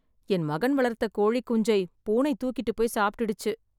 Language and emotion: Tamil, sad